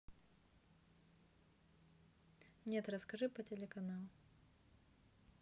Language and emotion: Russian, neutral